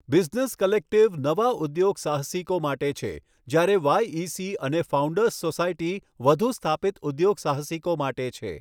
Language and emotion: Gujarati, neutral